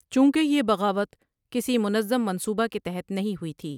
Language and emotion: Urdu, neutral